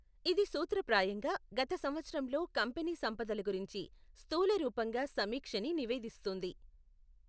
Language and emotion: Telugu, neutral